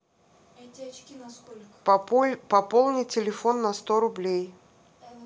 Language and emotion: Russian, neutral